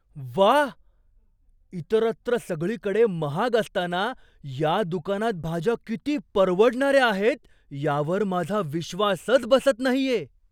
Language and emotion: Marathi, surprised